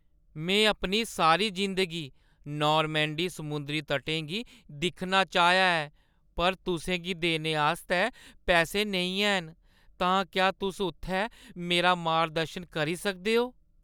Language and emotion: Dogri, sad